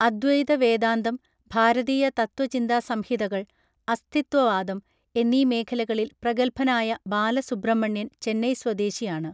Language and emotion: Malayalam, neutral